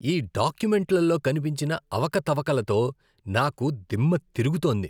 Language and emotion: Telugu, disgusted